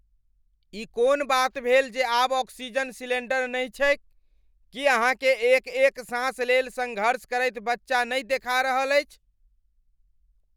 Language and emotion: Maithili, angry